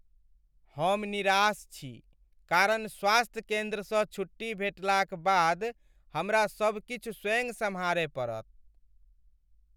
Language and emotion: Maithili, sad